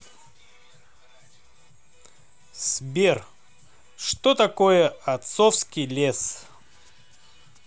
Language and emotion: Russian, positive